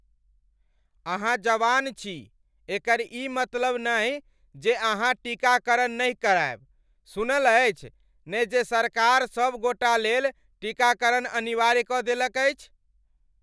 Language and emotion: Maithili, angry